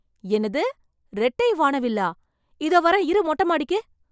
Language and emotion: Tamil, surprised